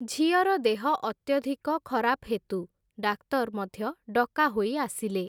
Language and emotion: Odia, neutral